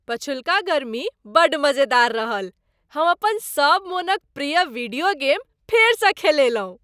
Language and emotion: Maithili, happy